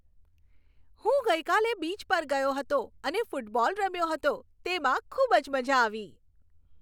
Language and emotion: Gujarati, happy